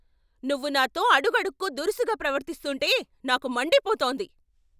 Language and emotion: Telugu, angry